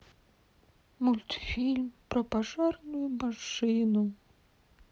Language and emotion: Russian, sad